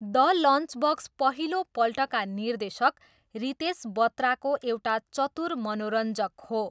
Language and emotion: Nepali, neutral